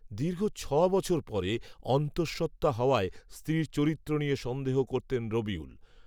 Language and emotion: Bengali, neutral